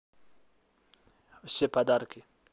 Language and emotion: Russian, neutral